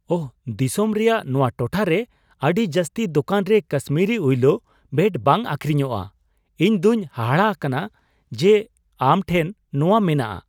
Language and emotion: Santali, surprised